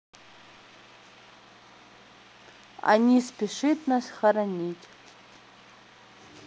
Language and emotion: Russian, neutral